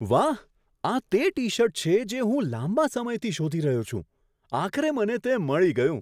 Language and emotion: Gujarati, surprised